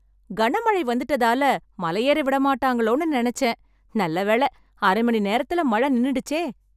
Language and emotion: Tamil, happy